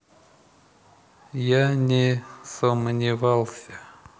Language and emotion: Russian, neutral